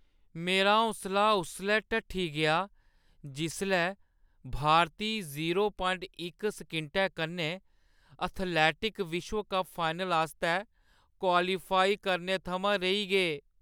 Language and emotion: Dogri, sad